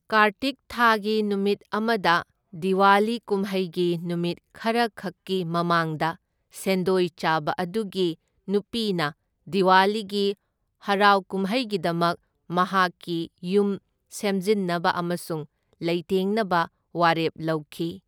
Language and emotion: Manipuri, neutral